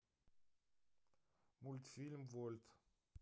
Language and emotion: Russian, neutral